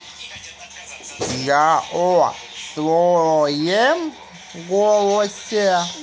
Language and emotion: Russian, neutral